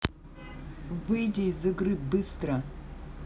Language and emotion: Russian, angry